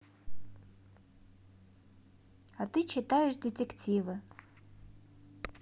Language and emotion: Russian, neutral